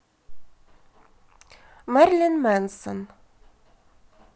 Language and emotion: Russian, neutral